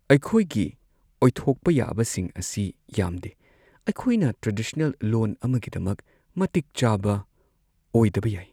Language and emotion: Manipuri, sad